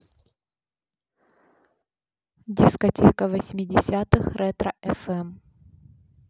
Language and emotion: Russian, neutral